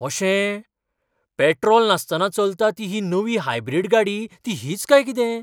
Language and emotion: Goan Konkani, surprised